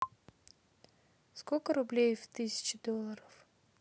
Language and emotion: Russian, neutral